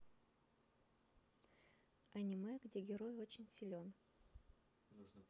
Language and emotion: Russian, neutral